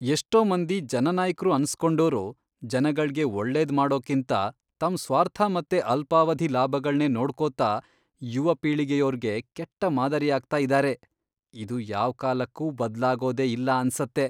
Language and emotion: Kannada, disgusted